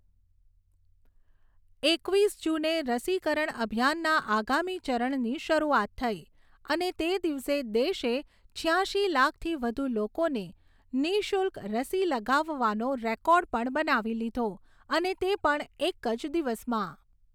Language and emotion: Gujarati, neutral